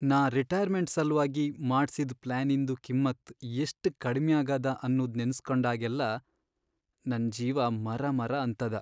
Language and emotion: Kannada, sad